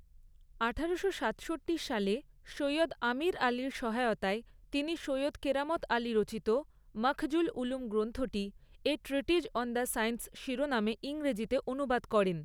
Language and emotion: Bengali, neutral